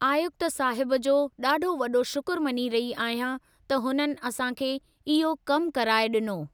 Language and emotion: Sindhi, neutral